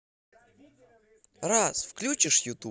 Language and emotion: Russian, positive